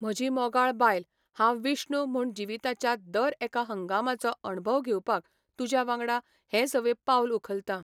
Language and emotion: Goan Konkani, neutral